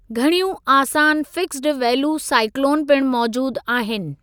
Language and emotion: Sindhi, neutral